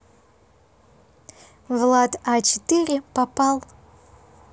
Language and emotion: Russian, neutral